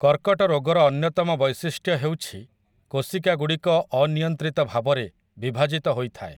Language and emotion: Odia, neutral